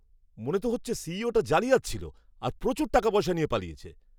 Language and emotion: Bengali, angry